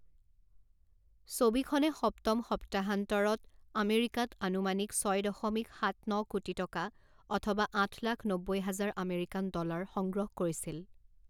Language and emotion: Assamese, neutral